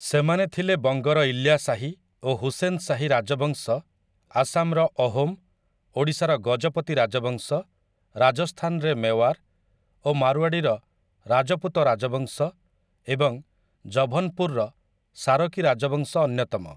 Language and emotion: Odia, neutral